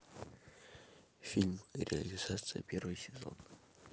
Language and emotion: Russian, neutral